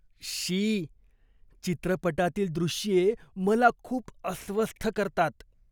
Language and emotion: Marathi, disgusted